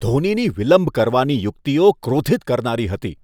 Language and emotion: Gujarati, disgusted